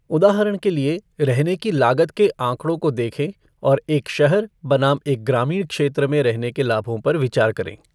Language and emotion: Hindi, neutral